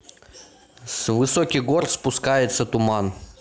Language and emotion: Russian, neutral